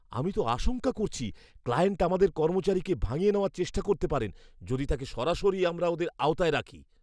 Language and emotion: Bengali, fearful